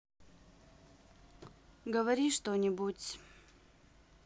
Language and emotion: Russian, neutral